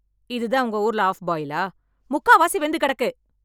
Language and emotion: Tamil, angry